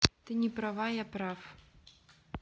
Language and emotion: Russian, neutral